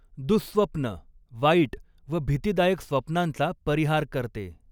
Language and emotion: Marathi, neutral